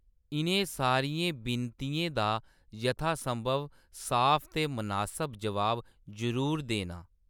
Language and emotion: Dogri, neutral